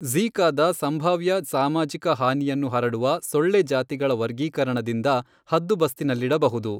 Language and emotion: Kannada, neutral